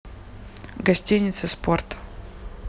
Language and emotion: Russian, neutral